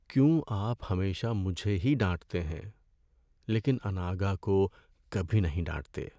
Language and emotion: Urdu, sad